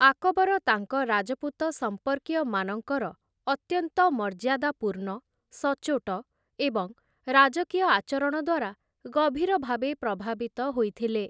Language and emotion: Odia, neutral